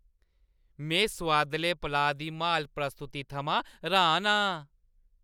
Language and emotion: Dogri, happy